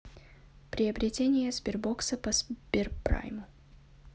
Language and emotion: Russian, neutral